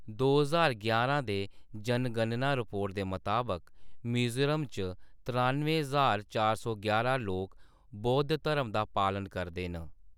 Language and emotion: Dogri, neutral